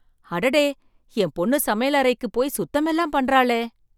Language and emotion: Tamil, surprised